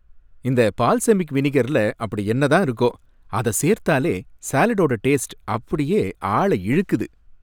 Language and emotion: Tamil, happy